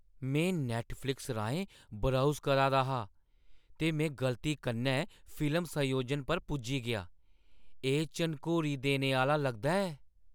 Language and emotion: Dogri, surprised